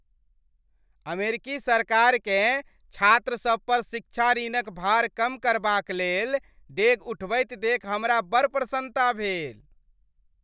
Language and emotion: Maithili, happy